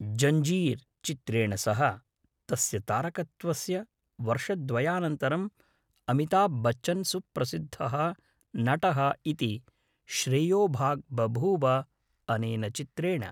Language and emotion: Sanskrit, neutral